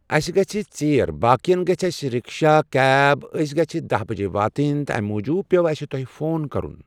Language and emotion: Kashmiri, neutral